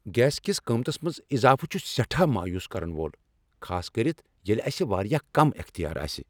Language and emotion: Kashmiri, angry